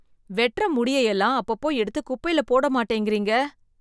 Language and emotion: Tamil, disgusted